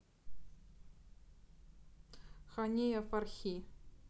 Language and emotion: Russian, neutral